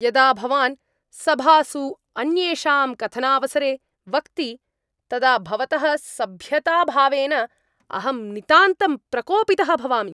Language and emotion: Sanskrit, angry